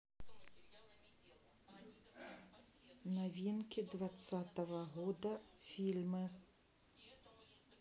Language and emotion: Russian, neutral